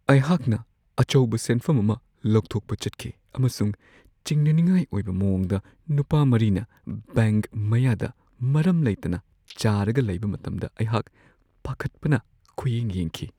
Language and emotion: Manipuri, fearful